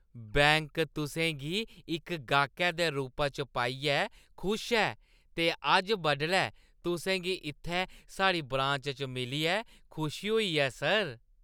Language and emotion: Dogri, happy